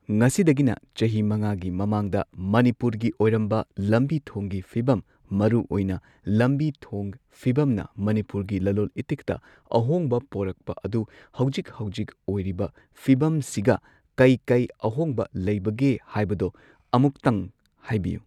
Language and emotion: Manipuri, neutral